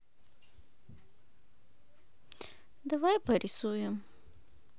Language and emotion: Russian, neutral